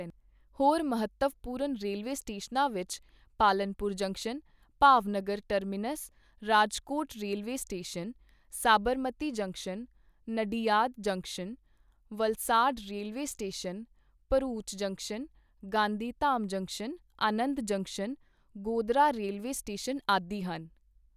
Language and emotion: Punjabi, neutral